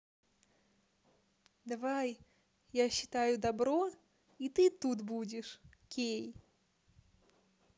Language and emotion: Russian, positive